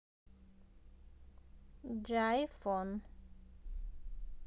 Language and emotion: Russian, neutral